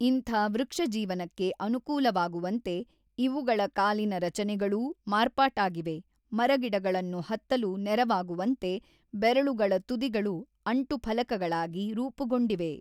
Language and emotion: Kannada, neutral